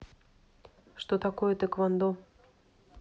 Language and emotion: Russian, neutral